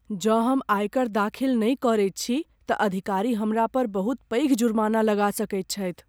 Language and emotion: Maithili, fearful